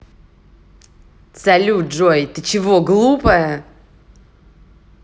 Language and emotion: Russian, angry